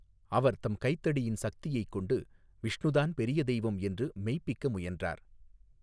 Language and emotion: Tamil, neutral